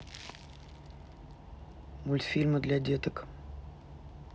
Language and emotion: Russian, neutral